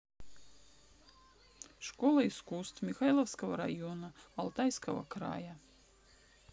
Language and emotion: Russian, neutral